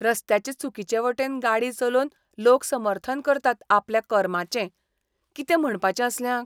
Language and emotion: Goan Konkani, disgusted